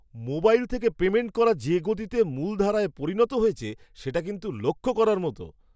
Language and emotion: Bengali, surprised